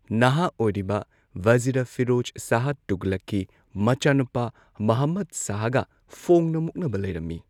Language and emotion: Manipuri, neutral